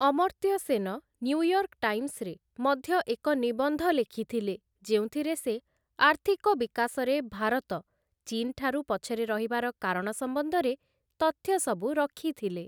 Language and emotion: Odia, neutral